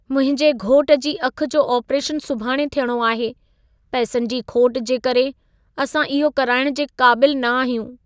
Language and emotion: Sindhi, sad